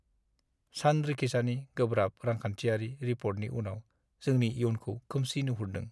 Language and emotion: Bodo, sad